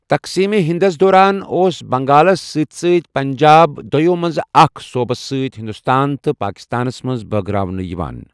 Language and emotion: Kashmiri, neutral